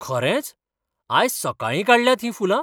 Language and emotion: Goan Konkani, surprised